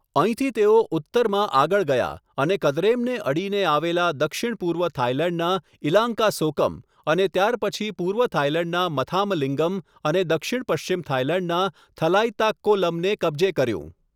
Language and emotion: Gujarati, neutral